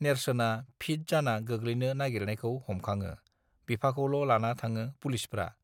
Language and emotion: Bodo, neutral